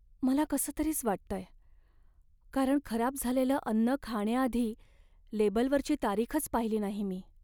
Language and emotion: Marathi, sad